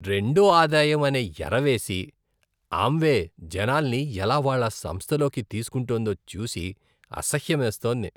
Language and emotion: Telugu, disgusted